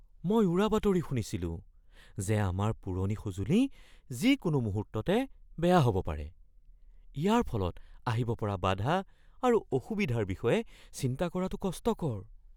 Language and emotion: Assamese, fearful